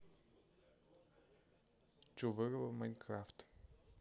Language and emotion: Russian, neutral